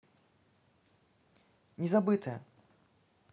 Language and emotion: Russian, neutral